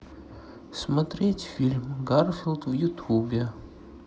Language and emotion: Russian, sad